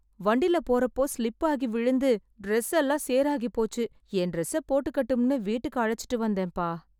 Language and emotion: Tamil, sad